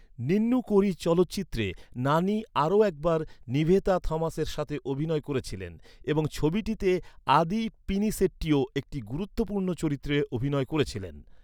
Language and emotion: Bengali, neutral